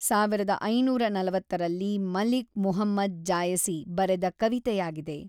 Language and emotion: Kannada, neutral